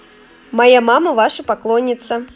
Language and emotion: Russian, positive